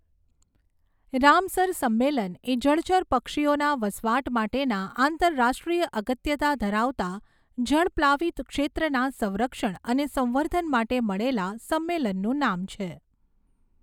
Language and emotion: Gujarati, neutral